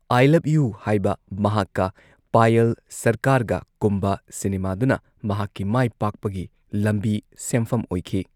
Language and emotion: Manipuri, neutral